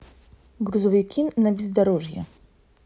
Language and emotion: Russian, neutral